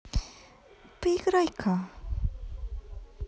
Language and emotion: Russian, positive